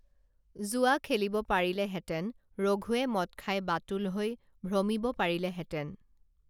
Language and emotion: Assamese, neutral